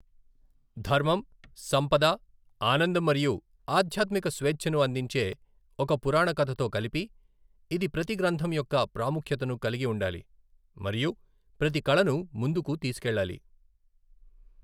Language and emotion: Telugu, neutral